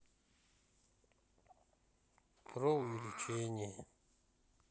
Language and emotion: Russian, neutral